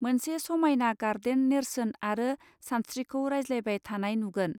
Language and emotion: Bodo, neutral